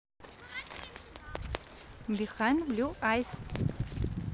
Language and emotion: Russian, positive